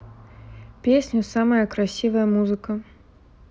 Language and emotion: Russian, neutral